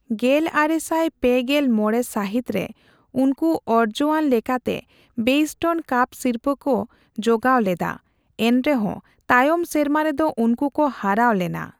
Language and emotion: Santali, neutral